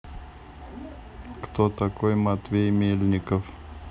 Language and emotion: Russian, neutral